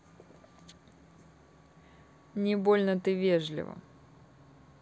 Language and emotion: Russian, neutral